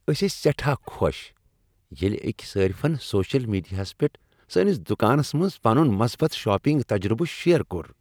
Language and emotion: Kashmiri, happy